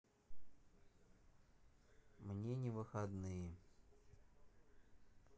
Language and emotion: Russian, sad